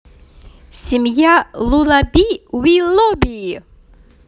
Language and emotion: Russian, positive